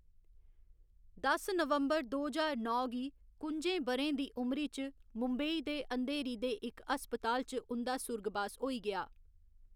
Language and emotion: Dogri, neutral